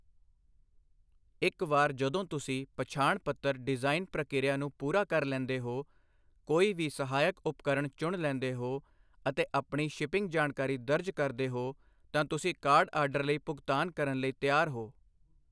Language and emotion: Punjabi, neutral